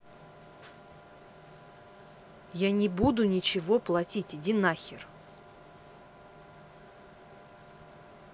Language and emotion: Russian, angry